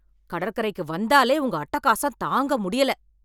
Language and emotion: Tamil, angry